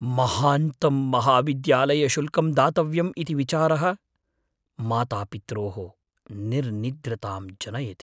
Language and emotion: Sanskrit, fearful